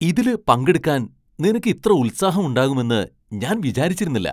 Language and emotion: Malayalam, surprised